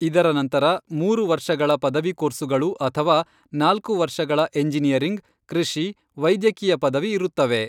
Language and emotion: Kannada, neutral